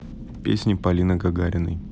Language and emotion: Russian, neutral